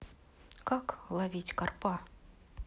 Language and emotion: Russian, neutral